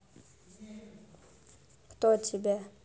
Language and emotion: Russian, neutral